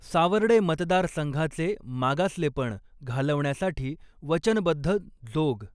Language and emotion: Marathi, neutral